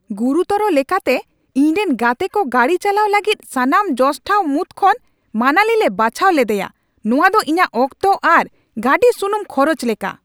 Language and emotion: Santali, angry